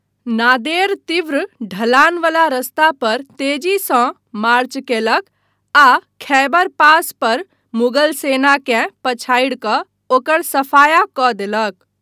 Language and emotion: Maithili, neutral